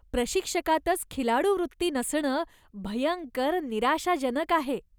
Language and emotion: Marathi, disgusted